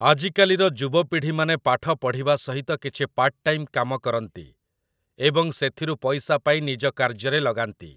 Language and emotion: Odia, neutral